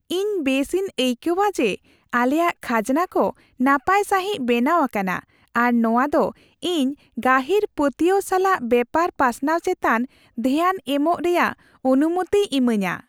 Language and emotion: Santali, happy